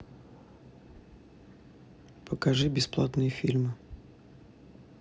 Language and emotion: Russian, neutral